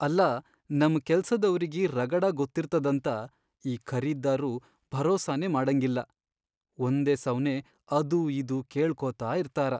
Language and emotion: Kannada, sad